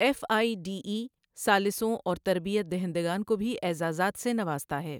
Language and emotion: Urdu, neutral